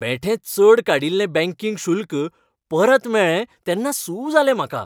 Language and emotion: Goan Konkani, happy